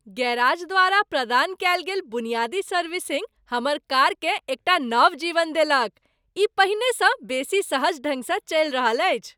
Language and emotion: Maithili, happy